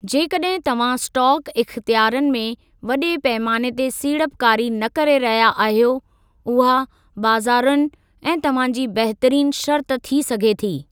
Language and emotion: Sindhi, neutral